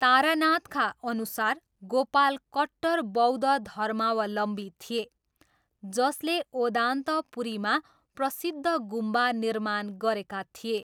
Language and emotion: Nepali, neutral